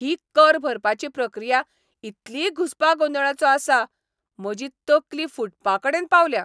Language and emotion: Goan Konkani, angry